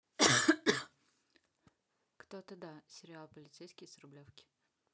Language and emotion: Russian, neutral